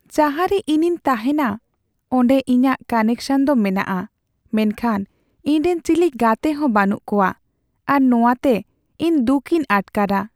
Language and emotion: Santali, sad